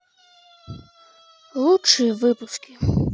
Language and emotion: Russian, sad